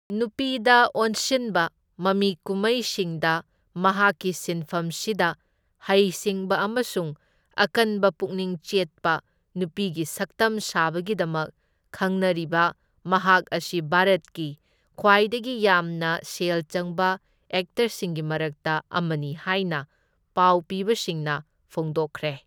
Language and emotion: Manipuri, neutral